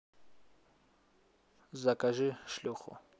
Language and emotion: Russian, neutral